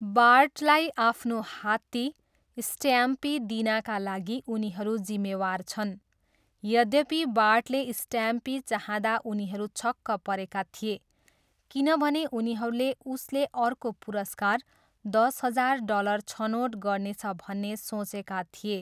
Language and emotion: Nepali, neutral